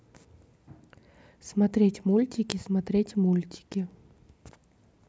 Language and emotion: Russian, neutral